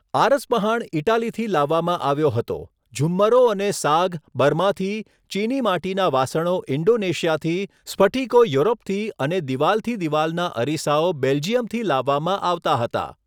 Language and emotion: Gujarati, neutral